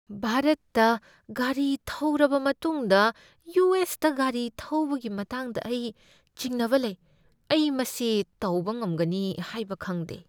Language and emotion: Manipuri, fearful